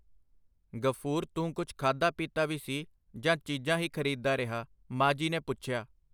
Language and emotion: Punjabi, neutral